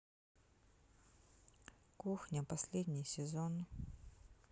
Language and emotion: Russian, sad